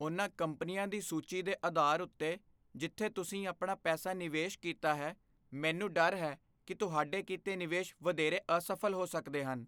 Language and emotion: Punjabi, fearful